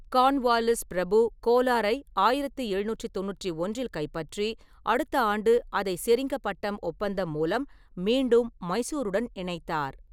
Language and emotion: Tamil, neutral